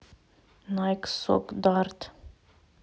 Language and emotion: Russian, neutral